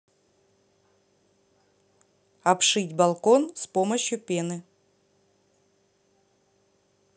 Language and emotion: Russian, neutral